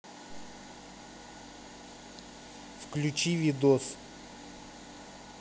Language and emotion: Russian, neutral